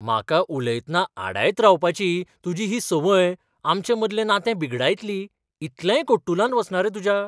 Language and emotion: Goan Konkani, surprised